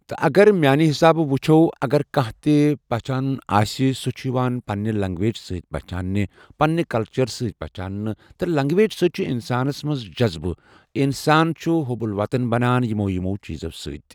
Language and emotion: Kashmiri, neutral